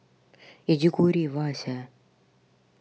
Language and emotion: Russian, angry